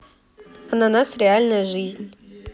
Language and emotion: Russian, neutral